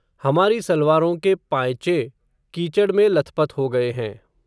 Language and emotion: Hindi, neutral